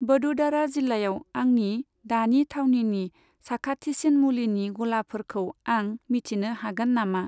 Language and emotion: Bodo, neutral